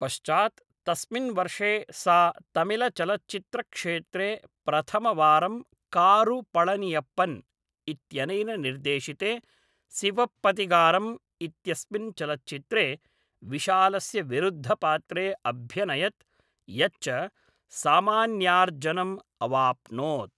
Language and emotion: Sanskrit, neutral